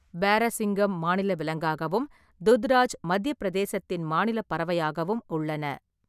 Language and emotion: Tamil, neutral